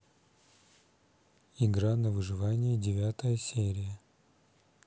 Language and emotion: Russian, neutral